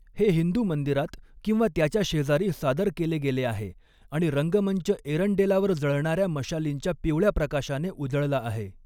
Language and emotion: Marathi, neutral